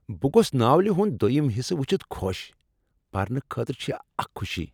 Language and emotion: Kashmiri, happy